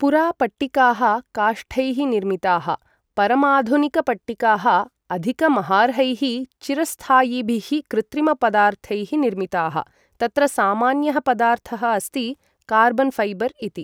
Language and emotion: Sanskrit, neutral